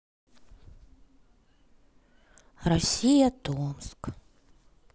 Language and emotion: Russian, sad